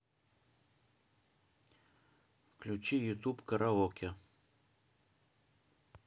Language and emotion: Russian, neutral